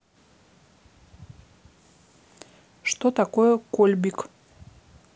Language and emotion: Russian, neutral